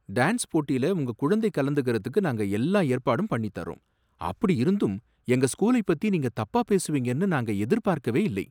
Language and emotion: Tamil, surprised